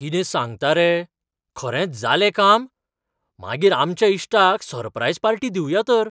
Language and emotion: Goan Konkani, surprised